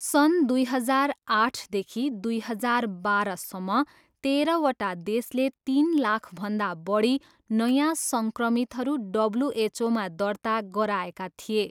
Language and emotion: Nepali, neutral